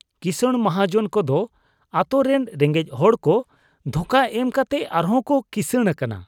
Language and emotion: Santali, disgusted